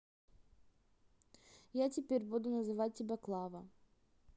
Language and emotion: Russian, neutral